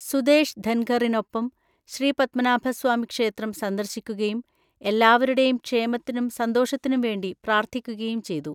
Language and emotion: Malayalam, neutral